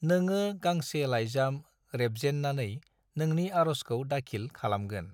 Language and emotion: Bodo, neutral